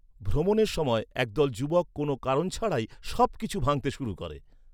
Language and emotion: Bengali, neutral